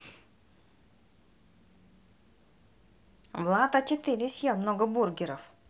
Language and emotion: Russian, positive